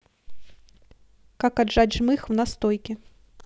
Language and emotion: Russian, neutral